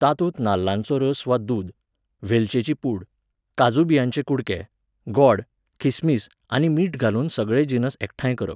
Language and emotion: Goan Konkani, neutral